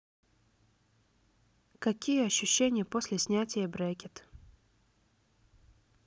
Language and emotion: Russian, neutral